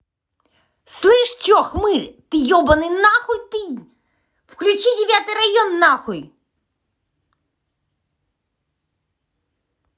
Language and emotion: Russian, angry